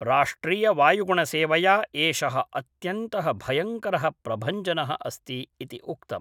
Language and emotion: Sanskrit, neutral